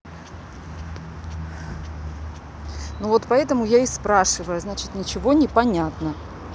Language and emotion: Russian, angry